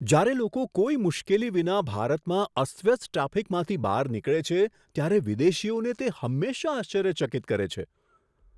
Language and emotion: Gujarati, surprised